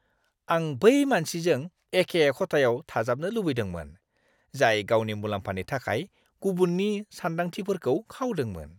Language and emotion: Bodo, disgusted